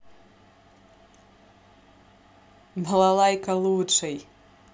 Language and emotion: Russian, positive